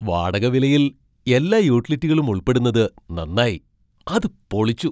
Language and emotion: Malayalam, surprised